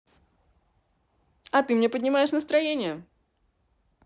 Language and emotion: Russian, positive